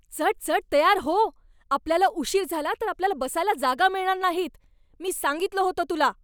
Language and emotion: Marathi, angry